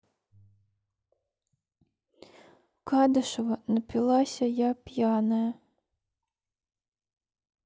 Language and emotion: Russian, sad